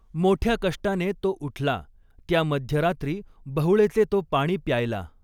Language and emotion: Marathi, neutral